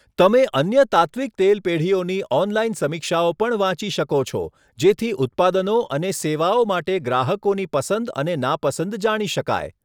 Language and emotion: Gujarati, neutral